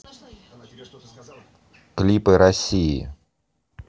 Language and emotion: Russian, neutral